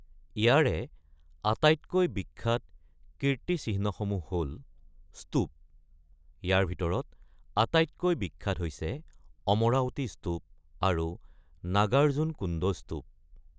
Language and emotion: Assamese, neutral